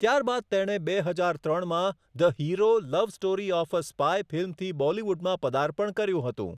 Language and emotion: Gujarati, neutral